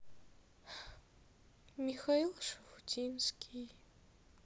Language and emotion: Russian, sad